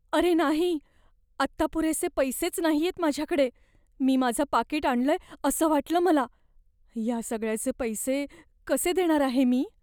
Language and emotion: Marathi, fearful